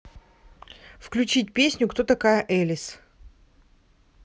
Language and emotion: Russian, neutral